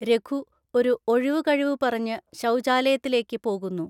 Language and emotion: Malayalam, neutral